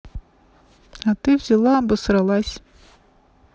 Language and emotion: Russian, neutral